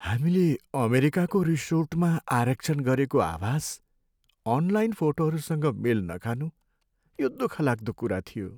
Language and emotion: Nepali, sad